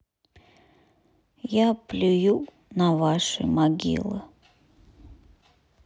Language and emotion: Russian, sad